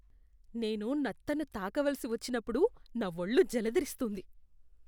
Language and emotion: Telugu, disgusted